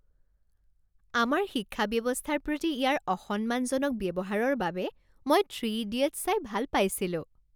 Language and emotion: Assamese, happy